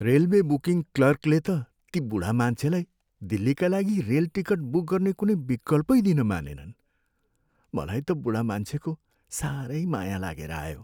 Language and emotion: Nepali, sad